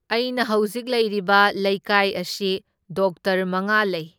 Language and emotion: Manipuri, neutral